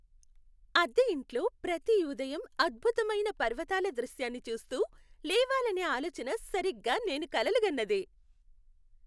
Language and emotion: Telugu, happy